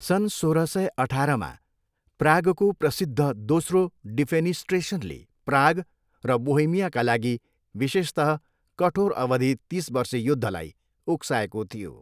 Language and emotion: Nepali, neutral